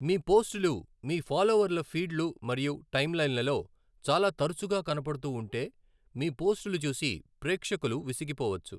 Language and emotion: Telugu, neutral